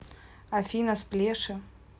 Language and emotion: Russian, neutral